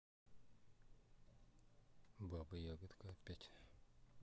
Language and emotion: Russian, neutral